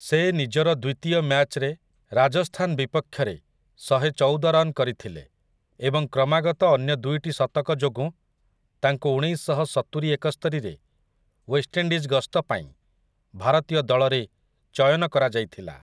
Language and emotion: Odia, neutral